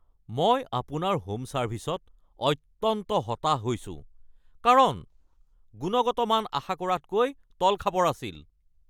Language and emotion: Assamese, angry